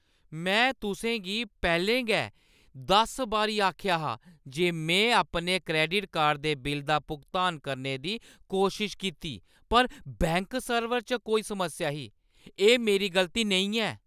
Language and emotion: Dogri, angry